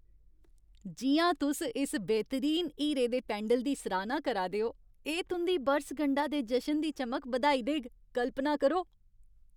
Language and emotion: Dogri, happy